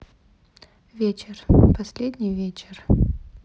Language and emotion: Russian, sad